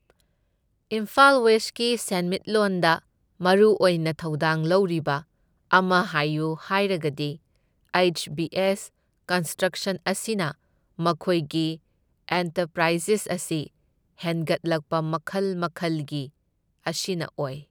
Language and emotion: Manipuri, neutral